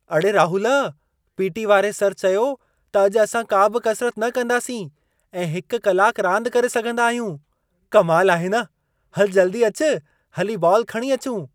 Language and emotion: Sindhi, surprised